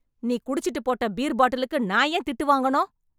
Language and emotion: Tamil, angry